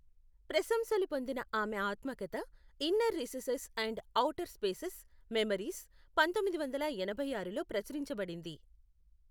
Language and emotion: Telugu, neutral